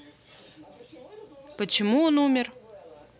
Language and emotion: Russian, neutral